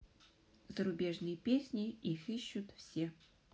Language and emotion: Russian, neutral